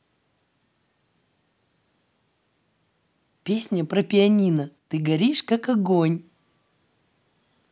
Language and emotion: Russian, positive